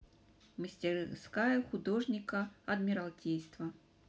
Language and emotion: Russian, neutral